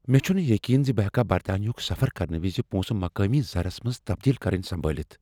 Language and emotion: Kashmiri, fearful